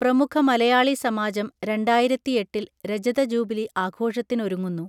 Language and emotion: Malayalam, neutral